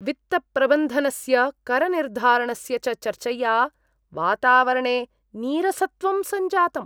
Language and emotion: Sanskrit, disgusted